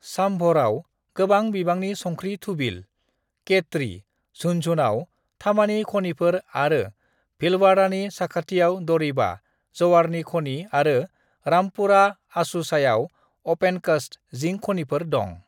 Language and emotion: Bodo, neutral